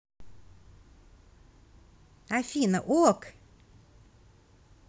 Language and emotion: Russian, positive